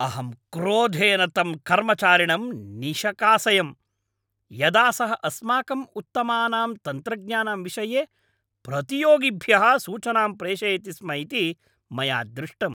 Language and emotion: Sanskrit, angry